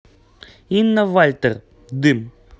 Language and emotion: Russian, neutral